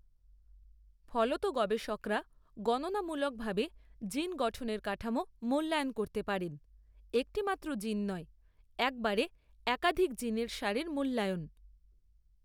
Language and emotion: Bengali, neutral